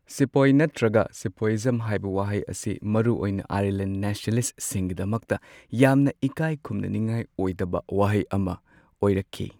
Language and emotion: Manipuri, neutral